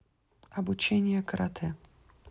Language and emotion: Russian, neutral